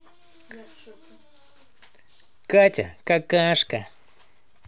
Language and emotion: Russian, positive